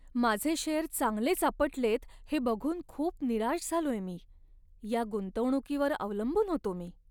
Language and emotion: Marathi, sad